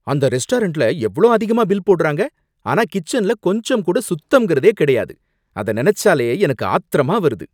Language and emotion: Tamil, angry